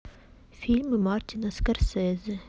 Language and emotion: Russian, neutral